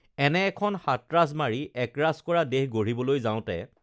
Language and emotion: Assamese, neutral